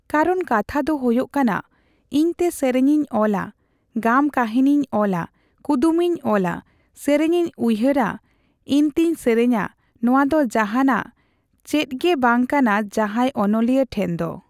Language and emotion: Santali, neutral